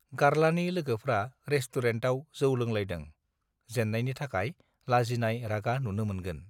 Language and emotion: Bodo, neutral